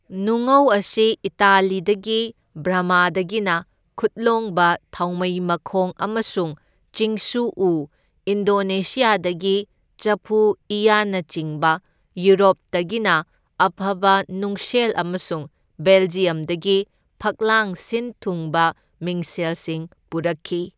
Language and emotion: Manipuri, neutral